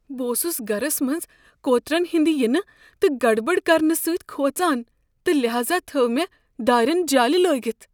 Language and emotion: Kashmiri, fearful